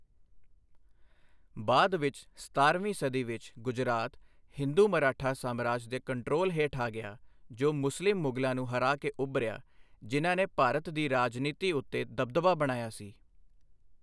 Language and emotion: Punjabi, neutral